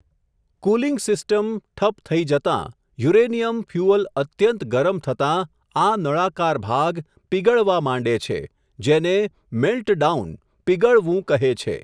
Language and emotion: Gujarati, neutral